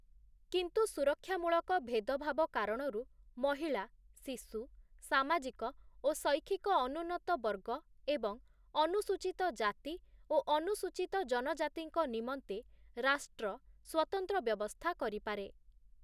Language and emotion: Odia, neutral